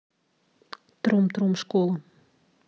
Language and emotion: Russian, neutral